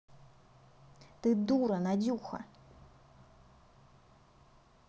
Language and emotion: Russian, angry